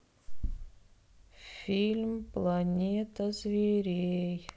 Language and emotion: Russian, sad